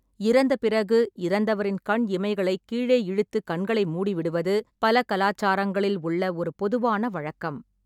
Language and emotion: Tamil, neutral